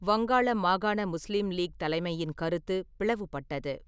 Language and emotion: Tamil, neutral